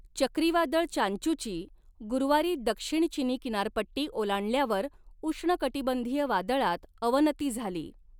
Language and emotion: Marathi, neutral